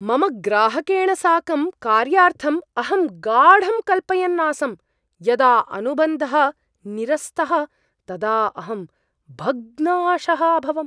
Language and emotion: Sanskrit, surprised